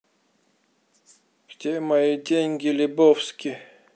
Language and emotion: Russian, neutral